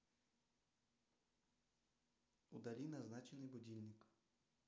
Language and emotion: Russian, neutral